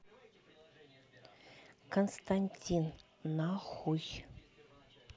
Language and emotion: Russian, neutral